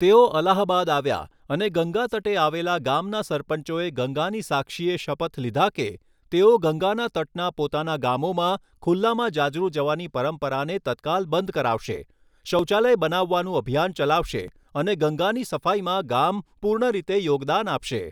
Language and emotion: Gujarati, neutral